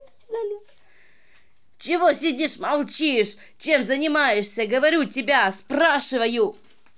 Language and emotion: Russian, angry